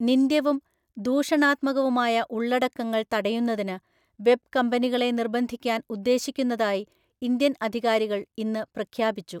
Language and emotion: Malayalam, neutral